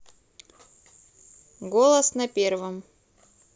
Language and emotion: Russian, neutral